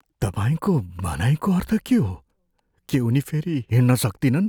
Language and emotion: Nepali, fearful